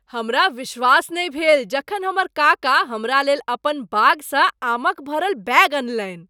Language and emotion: Maithili, surprised